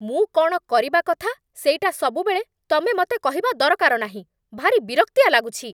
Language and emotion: Odia, angry